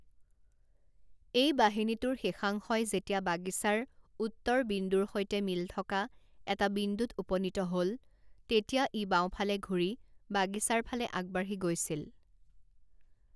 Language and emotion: Assamese, neutral